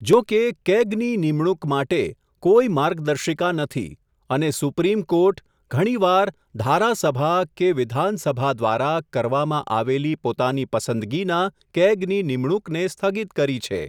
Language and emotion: Gujarati, neutral